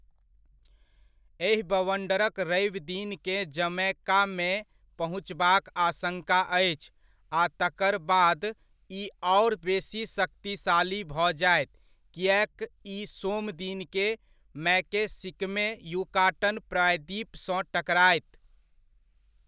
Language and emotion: Maithili, neutral